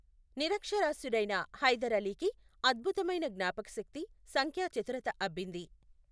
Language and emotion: Telugu, neutral